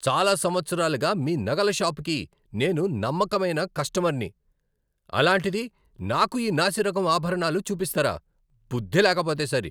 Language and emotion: Telugu, angry